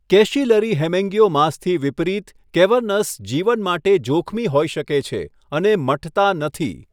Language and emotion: Gujarati, neutral